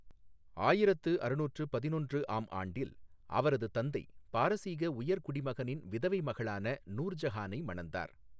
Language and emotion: Tamil, neutral